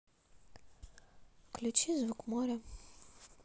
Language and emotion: Russian, neutral